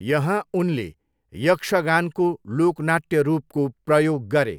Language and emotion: Nepali, neutral